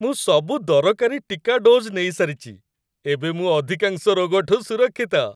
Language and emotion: Odia, happy